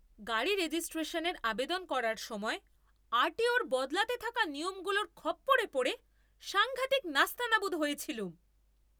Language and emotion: Bengali, angry